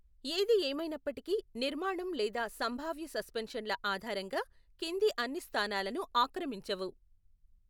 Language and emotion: Telugu, neutral